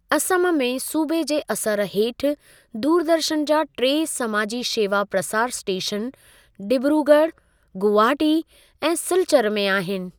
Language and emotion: Sindhi, neutral